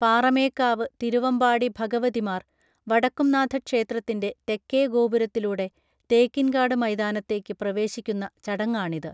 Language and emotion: Malayalam, neutral